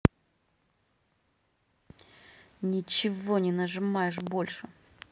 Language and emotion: Russian, angry